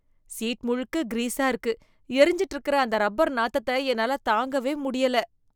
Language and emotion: Tamil, disgusted